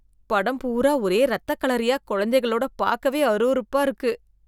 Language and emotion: Tamil, disgusted